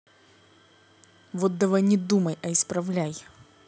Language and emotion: Russian, angry